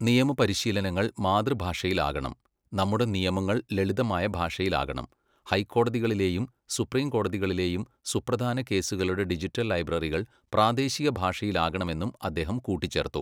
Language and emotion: Malayalam, neutral